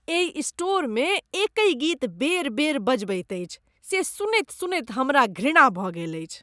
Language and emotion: Maithili, disgusted